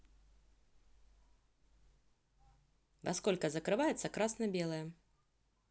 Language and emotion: Russian, neutral